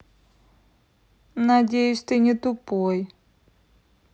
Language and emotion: Russian, neutral